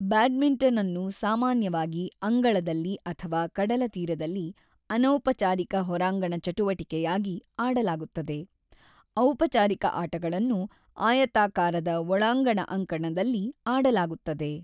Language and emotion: Kannada, neutral